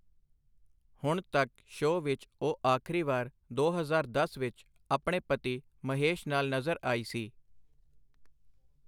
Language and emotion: Punjabi, neutral